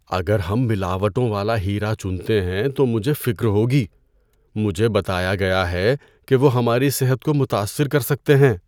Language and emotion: Urdu, fearful